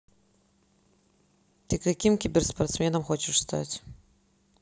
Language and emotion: Russian, neutral